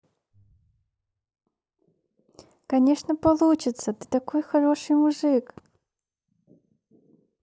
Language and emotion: Russian, positive